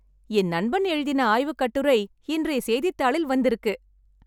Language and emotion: Tamil, happy